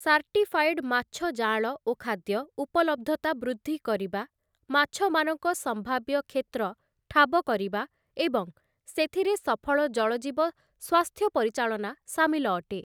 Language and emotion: Odia, neutral